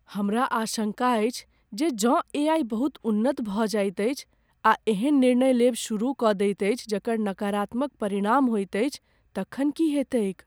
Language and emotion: Maithili, fearful